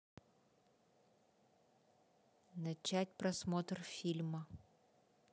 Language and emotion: Russian, neutral